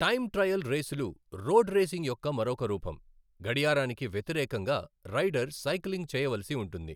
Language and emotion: Telugu, neutral